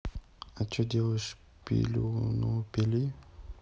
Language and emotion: Russian, neutral